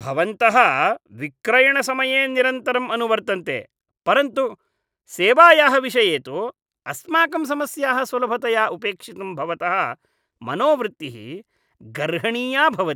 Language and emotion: Sanskrit, disgusted